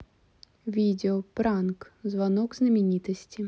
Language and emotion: Russian, neutral